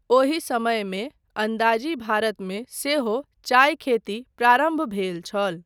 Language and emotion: Maithili, neutral